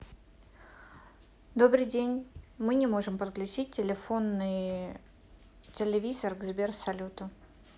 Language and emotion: Russian, neutral